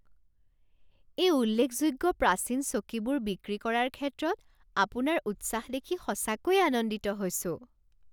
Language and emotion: Assamese, surprised